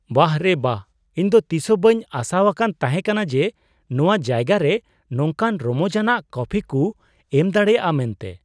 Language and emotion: Santali, surprised